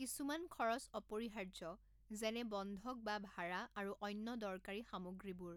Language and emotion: Assamese, neutral